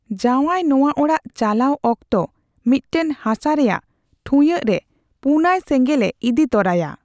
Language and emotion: Santali, neutral